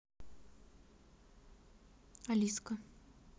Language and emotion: Russian, neutral